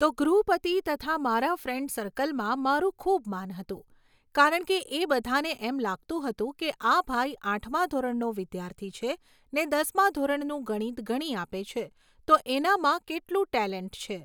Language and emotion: Gujarati, neutral